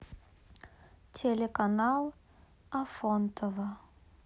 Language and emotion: Russian, neutral